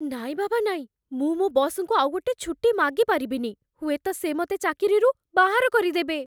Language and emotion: Odia, fearful